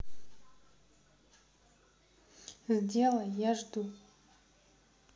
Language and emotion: Russian, neutral